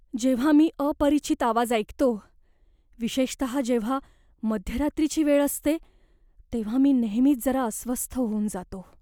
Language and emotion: Marathi, fearful